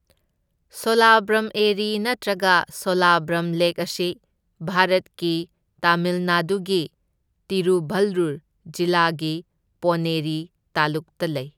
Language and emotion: Manipuri, neutral